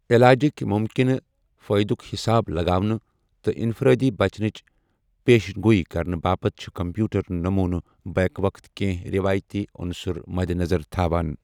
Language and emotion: Kashmiri, neutral